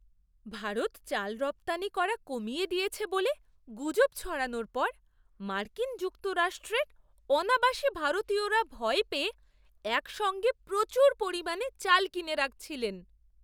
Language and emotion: Bengali, surprised